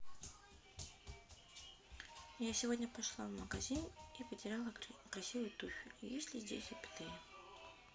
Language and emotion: Russian, neutral